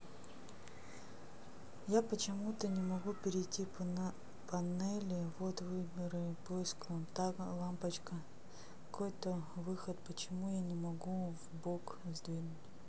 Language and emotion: Russian, neutral